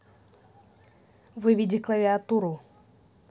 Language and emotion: Russian, neutral